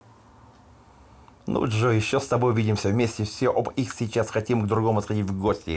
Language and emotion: Russian, positive